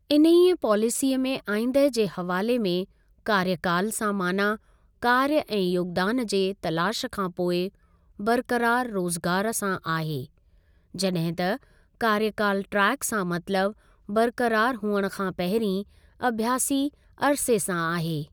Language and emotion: Sindhi, neutral